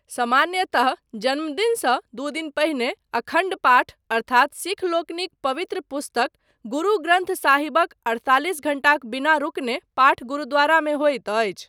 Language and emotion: Maithili, neutral